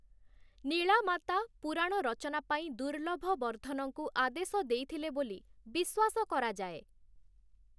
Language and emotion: Odia, neutral